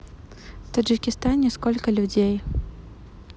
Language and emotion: Russian, neutral